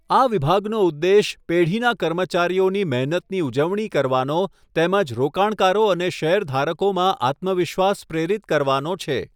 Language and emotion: Gujarati, neutral